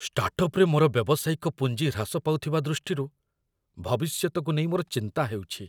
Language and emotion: Odia, fearful